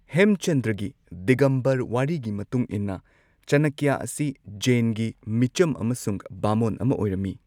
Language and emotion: Manipuri, neutral